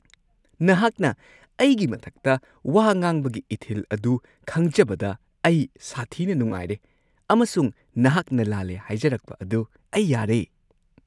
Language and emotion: Manipuri, happy